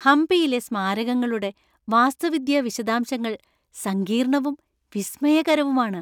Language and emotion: Malayalam, happy